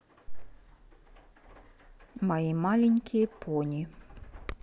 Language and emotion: Russian, neutral